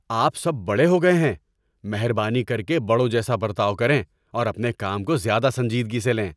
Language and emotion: Urdu, angry